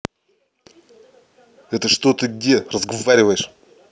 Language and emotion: Russian, angry